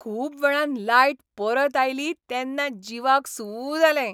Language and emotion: Goan Konkani, happy